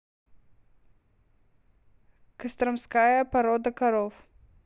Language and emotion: Russian, neutral